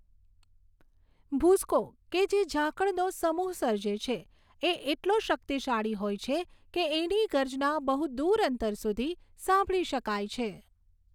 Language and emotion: Gujarati, neutral